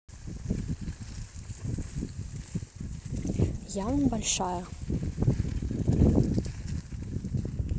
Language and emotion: Russian, neutral